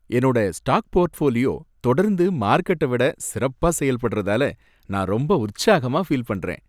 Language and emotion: Tamil, happy